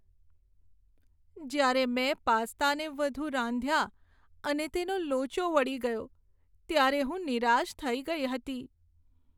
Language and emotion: Gujarati, sad